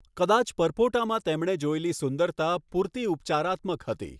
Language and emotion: Gujarati, neutral